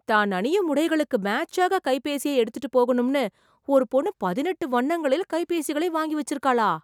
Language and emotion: Tamil, surprised